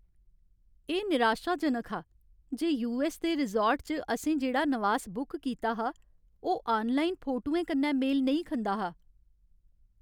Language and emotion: Dogri, sad